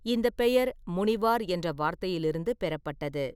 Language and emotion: Tamil, neutral